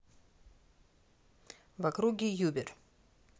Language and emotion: Russian, neutral